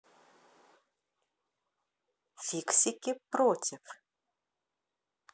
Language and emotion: Russian, positive